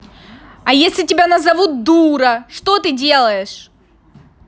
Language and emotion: Russian, angry